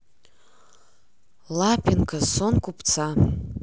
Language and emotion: Russian, neutral